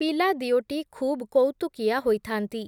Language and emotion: Odia, neutral